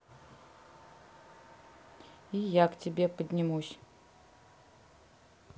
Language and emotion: Russian, neutral